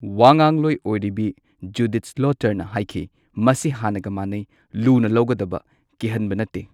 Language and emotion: Manipuri, neutral